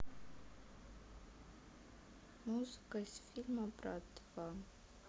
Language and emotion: Russian, neutral